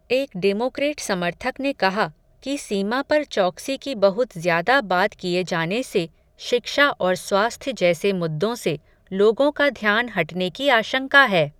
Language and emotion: Hindi, neutral